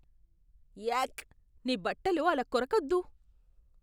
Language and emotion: Telugu, disgusted